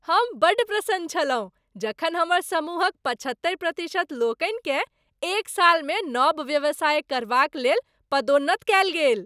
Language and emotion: Maithili, happy